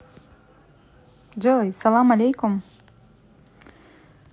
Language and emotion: Russian, positive